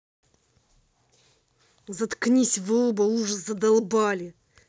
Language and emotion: Russian, angry